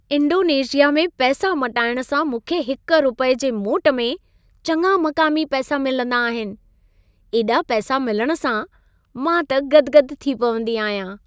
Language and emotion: Sindhi, happy